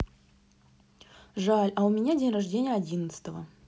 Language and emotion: Russian, neutral